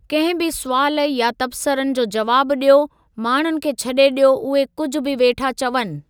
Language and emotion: Sindhi, neutral